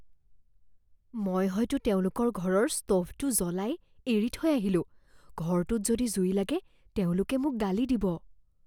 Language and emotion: Assamese, fearful